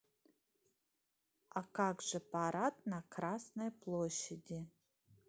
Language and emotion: Russian, neutral